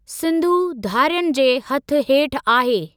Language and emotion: Sindhi, neutral